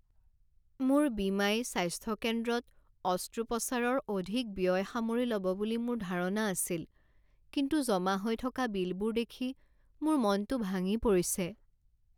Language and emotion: Assamese, sad